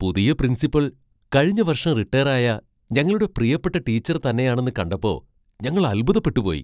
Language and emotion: Malayalam, surprised